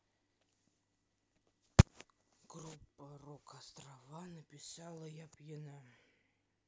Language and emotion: Russian, neutral